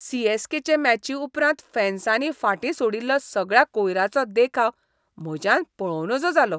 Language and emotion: Goan Konkani, disgusted